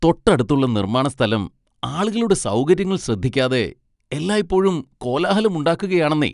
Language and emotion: Malayalam, disgusted